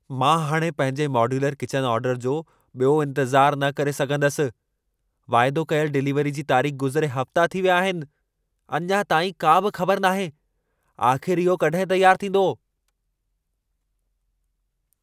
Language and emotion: Sindhi, angry